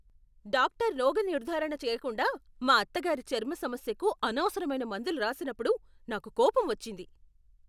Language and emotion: Telugu, angry